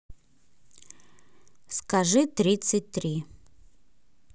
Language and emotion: Russian, neutral